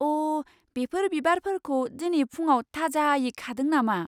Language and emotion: Bodo, surprised